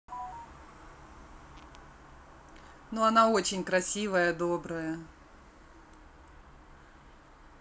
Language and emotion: Russian, positive